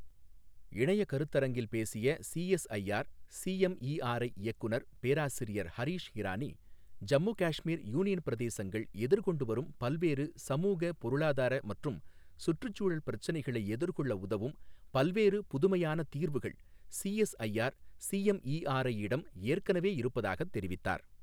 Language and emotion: Tamil, neutral